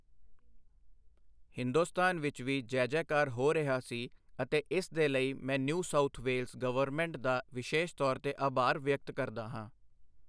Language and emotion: Punjabi, neutral